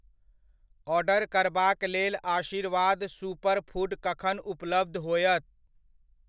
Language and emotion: Maithili, neutral